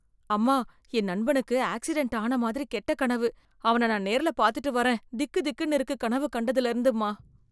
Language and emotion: Tamil, fearful